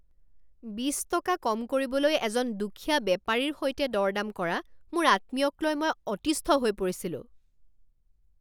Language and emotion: Assamese, angry